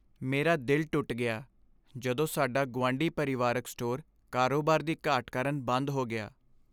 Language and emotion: Punjabi, sad